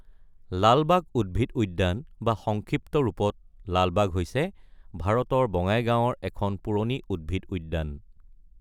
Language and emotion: Assamese, neutral